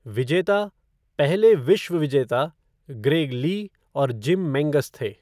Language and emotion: Hindi, neutral